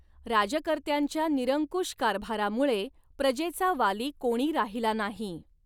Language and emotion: Marathi, neutral